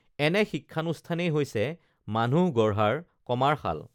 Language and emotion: Assamese, neutral